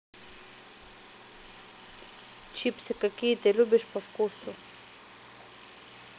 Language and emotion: Russian, neutral